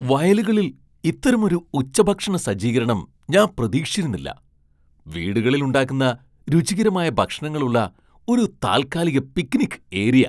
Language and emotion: Malayalam, surprised